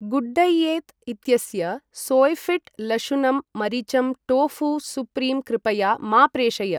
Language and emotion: Sanskrit, neutral